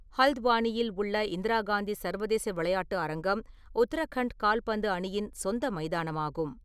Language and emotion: Tamil, neutral